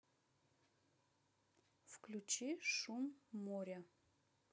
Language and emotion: Russian, neutral